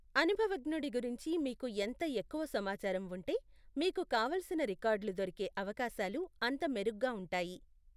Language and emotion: Telugu, neutral